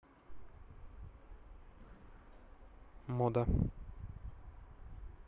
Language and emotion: Russian, neutral